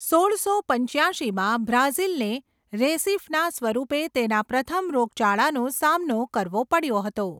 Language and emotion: Gujarati, neutral